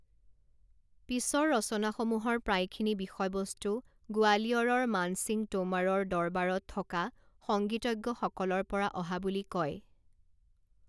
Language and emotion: Assamese, neutral